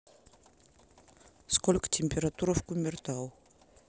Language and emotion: Russian, neutral